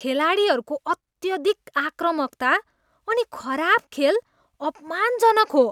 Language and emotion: Nepali, disgusted